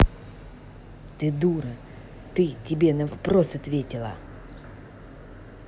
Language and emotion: Russian, angry